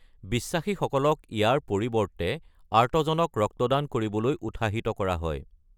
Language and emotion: Assamese, neutral